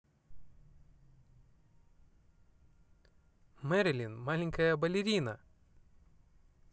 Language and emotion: Russian, positive